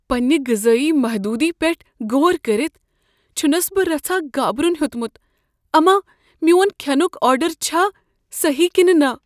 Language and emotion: Kashmiri, fearful